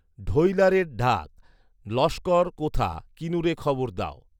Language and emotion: Bengali, neutral